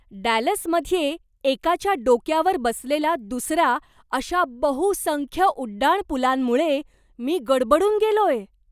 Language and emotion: Marathi, surprised